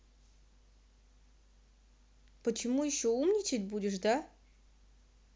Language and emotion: Russian, angry